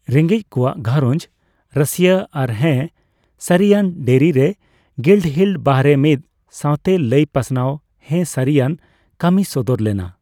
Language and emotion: Santali, neutral